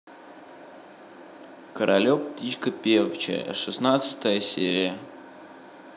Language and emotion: Russian, neutral